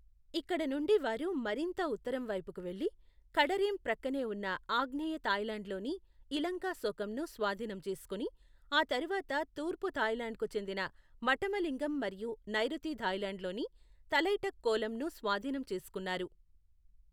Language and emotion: Telugu, neutral